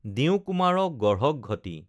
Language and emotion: Assamese, neutral